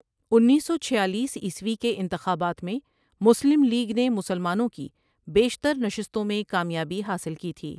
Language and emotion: Urdu, neutral